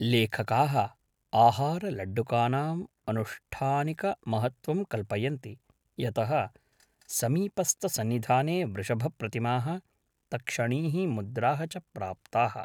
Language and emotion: Sanskrit, neutral